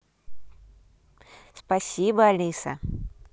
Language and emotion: Russian, positive